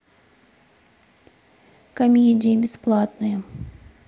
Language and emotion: Russian, neutral